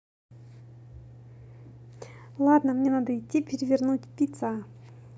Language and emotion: Russian, positive